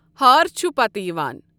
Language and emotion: Kashmiri, neutral